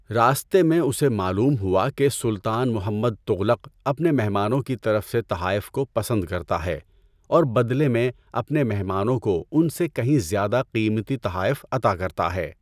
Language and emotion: Urdu, neutral